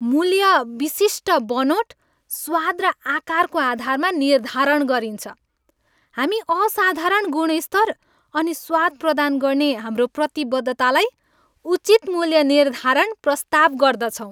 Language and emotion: Nepali, happy